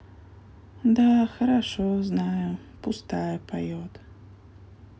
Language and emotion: Russian, sad